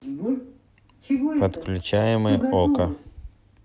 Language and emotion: Russian, neutral